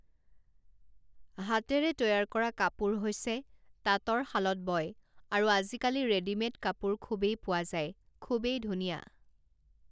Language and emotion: Assamese, neutral